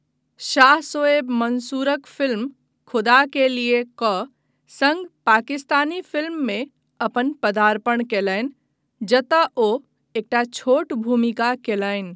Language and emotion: Maithili, neutral